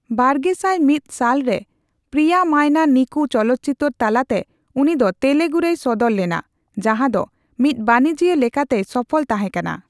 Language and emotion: Santali, neutral